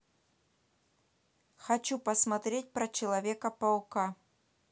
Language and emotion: Russian, neutral